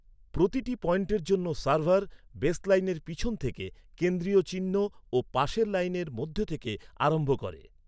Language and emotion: Bengali, neutral